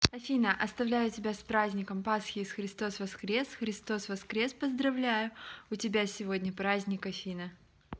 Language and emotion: Russian, neutral